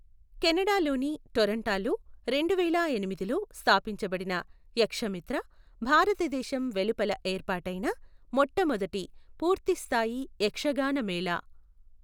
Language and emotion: Telugu, neutral